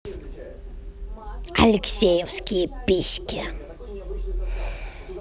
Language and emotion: Russian, angry